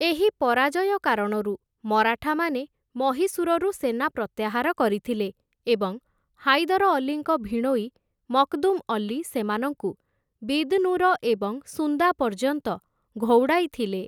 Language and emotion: Odia, neutral